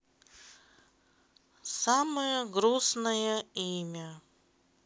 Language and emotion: Russian, sad